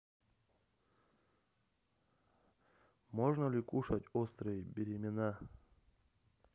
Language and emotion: Russian, neutral